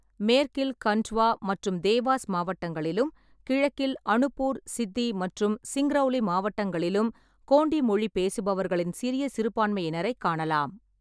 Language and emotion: Tamil, neutral